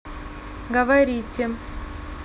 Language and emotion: Russian, neutral